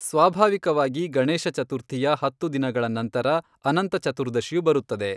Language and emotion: Kannada, neutral